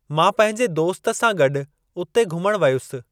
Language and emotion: Sindhi, neutral